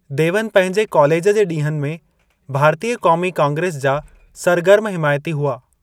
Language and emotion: Sindhi, neutral